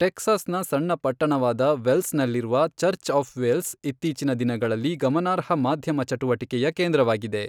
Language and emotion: Kannada, neutral